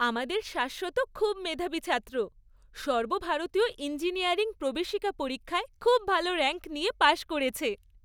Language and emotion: Bengali, happy